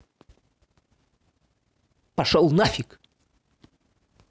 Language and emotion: Russian, angry